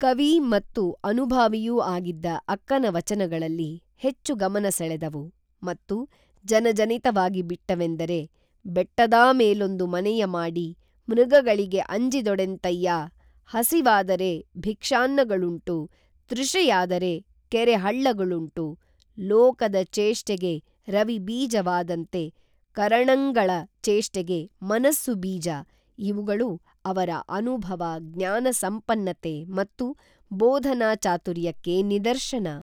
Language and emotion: Kannada, neutral